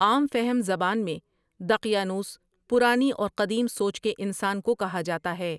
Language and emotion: Urdu, neutral